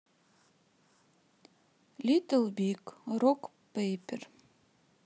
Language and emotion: Russian, neutral